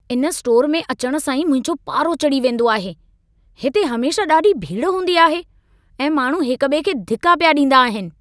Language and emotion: Sindhi, angry